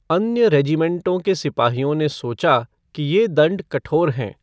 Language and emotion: Hindi, neutral